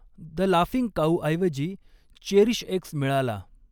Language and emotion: Marathi, neutral